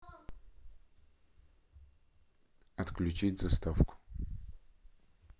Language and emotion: Russian, neutral